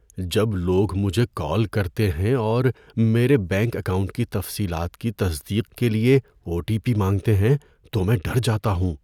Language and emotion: Urdu, fearful